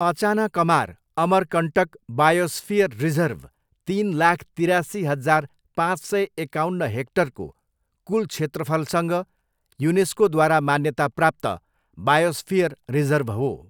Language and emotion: Nepali, neutral